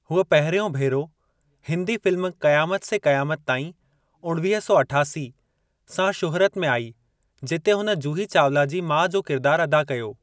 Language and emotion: Sindhi, neutral